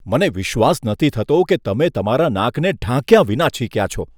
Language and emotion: Gujarati, disgusted